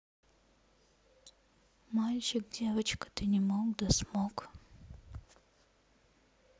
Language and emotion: Russian, neutral